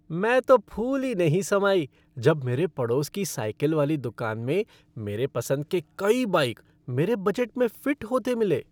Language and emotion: Hindi, happy